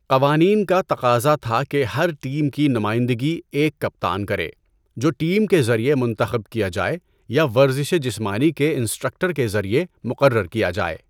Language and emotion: Urdu, neutral